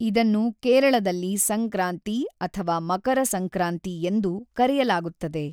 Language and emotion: Kannada, neutral